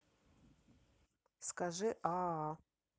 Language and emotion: Russian, neutral